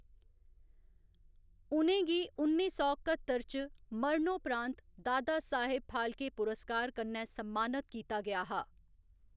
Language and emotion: Dogri, neutral